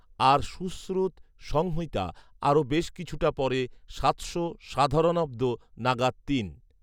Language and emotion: Bengali, neutral